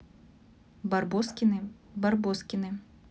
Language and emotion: Russian, neutral